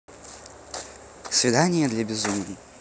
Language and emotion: Russian, neutral